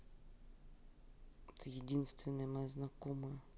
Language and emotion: Russian, sad